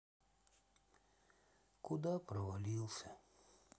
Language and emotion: Russian, sad